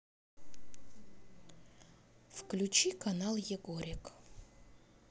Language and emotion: Russian, neutral